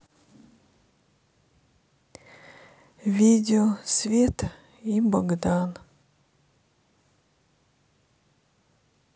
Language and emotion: Russian, sad